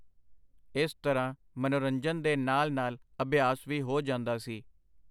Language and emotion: Punjabi, neutral